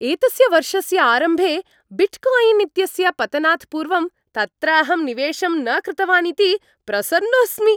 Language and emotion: Sanskrit, happy